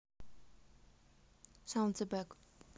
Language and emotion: Russian, neutral